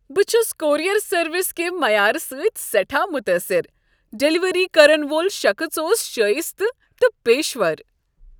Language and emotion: Kashmiri, happy